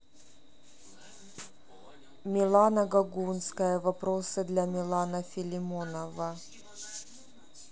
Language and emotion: Russian, neutral